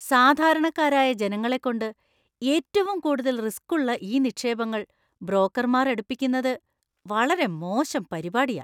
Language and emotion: Malayalam, disgusted